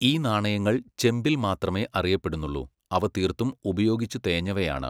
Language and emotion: Malayalam, neutral